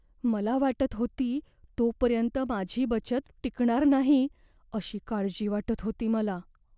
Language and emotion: Marathi, fearful